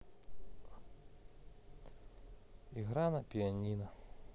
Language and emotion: Russian, sad